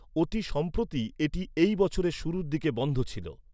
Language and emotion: Bengali, neutral